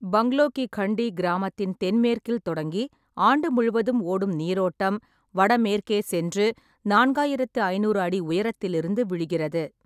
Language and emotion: Tamil, neutral